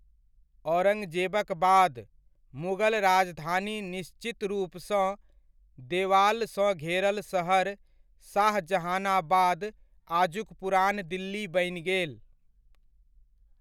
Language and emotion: Maithili, neutral